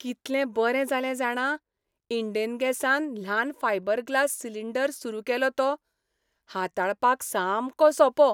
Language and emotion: Goan Konkani, happy